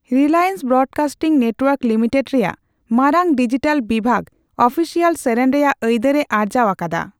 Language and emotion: Santali, neutral